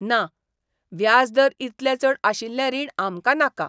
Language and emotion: Goan Konkani, disgusted